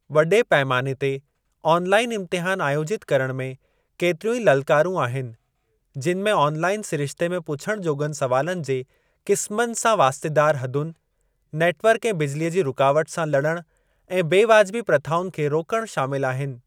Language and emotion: Sindhi, neutral